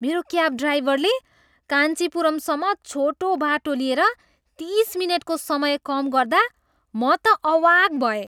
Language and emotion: Nepali, surprised